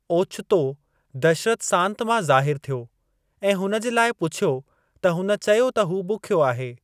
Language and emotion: Sindhi, neutral